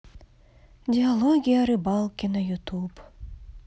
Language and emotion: Russian, sad